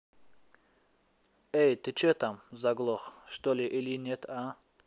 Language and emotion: Russian, angry